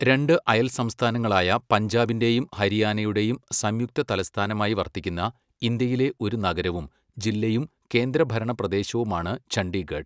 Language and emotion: Malayalam, neutral